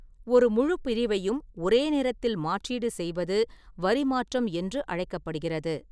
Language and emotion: Tamil, neutral